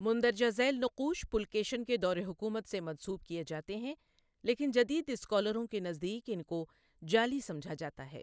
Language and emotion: Urdu, neutral